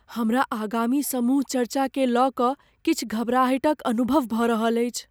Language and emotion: Maithili, fearful